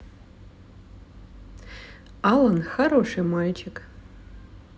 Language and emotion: Russian, neutral